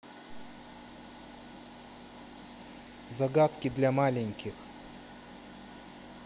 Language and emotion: Russian, neutral